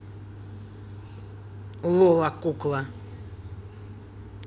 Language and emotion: Russian, angry